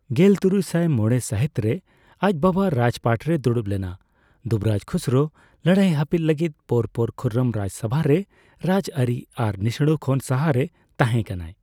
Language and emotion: Santali, neutral